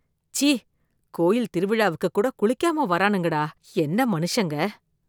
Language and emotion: Tamil, disgusted